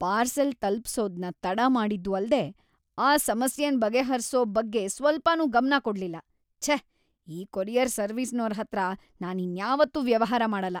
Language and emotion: Kannada, disgusted